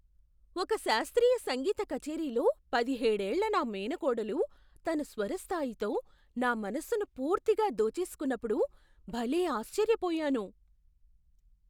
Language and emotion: Telugu, surprised